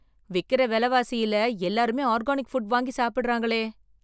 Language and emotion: Tamil, surprised